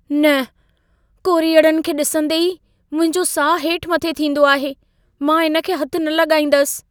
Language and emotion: Sindhi, fearful